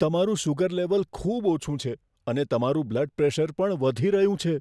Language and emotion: Gujarati, fearful